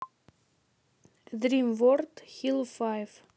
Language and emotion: Russian, neutral